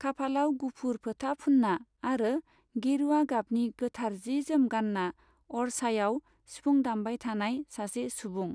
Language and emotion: Bodo, neutral